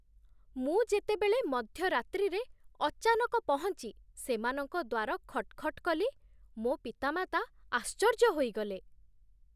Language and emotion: Odia, surprised